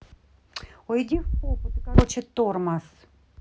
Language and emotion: Russian, angry